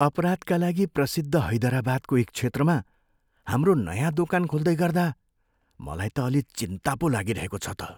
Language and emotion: Nepali, fearful